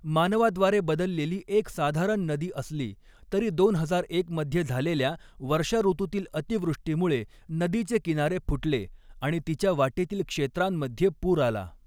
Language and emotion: Marathi, neutral